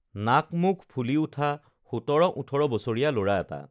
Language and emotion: Assamese, neutral